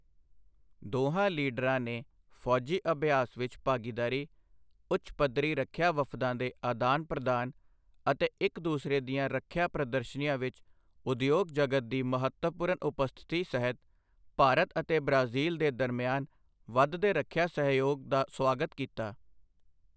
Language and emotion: Punjabi, neutral